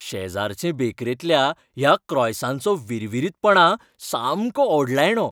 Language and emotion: Goan Konkani, happy